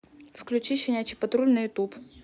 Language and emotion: Russian, neutral